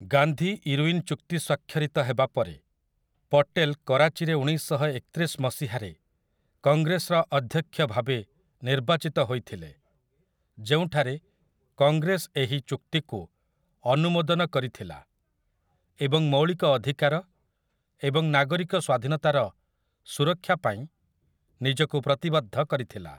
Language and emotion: Odia, neutral